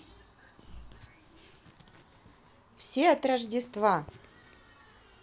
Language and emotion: Russian, positive